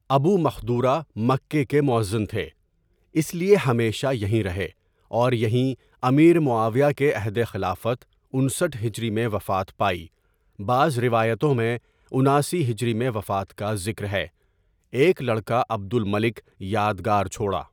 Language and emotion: Urdu, neutral